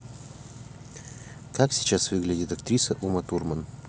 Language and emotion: Russian, neutral